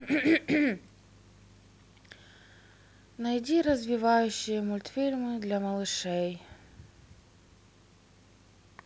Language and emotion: Russian, sad